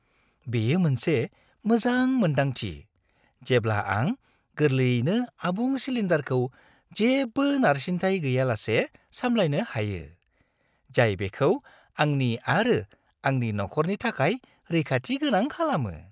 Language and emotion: Bodo, happy